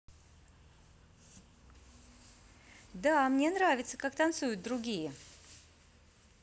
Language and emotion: Russian, positive